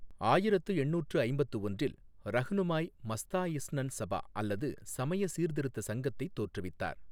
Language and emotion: Tamil, neutral